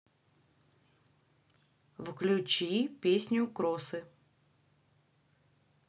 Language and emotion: Russian, neutral